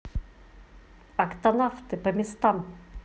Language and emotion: Russian, positive